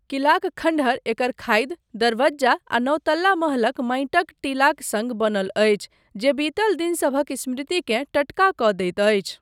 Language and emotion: Maithili, neutral